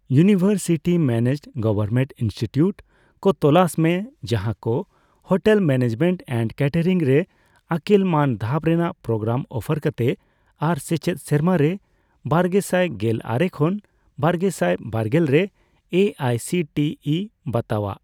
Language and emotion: Santali, neutral